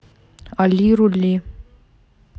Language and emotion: Russian, neutral